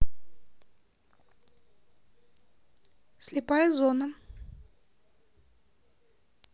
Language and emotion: Russian, neutral